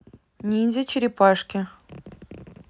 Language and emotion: Russian, neutral